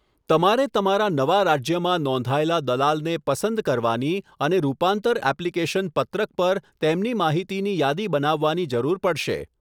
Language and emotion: Gujarati, neutral